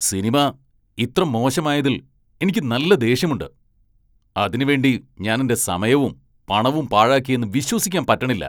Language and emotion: Malayalam, angry